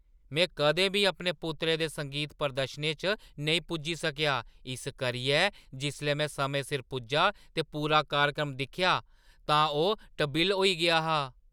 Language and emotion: Dogri, surprised